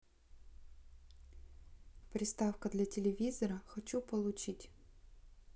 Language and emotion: Russian, neutral